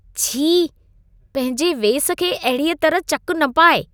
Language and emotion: Sindhi, disgusted